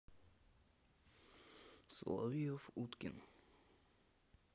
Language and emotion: Russian, neutral